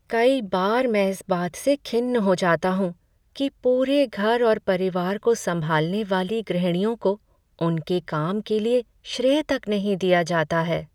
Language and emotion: Hindi, sad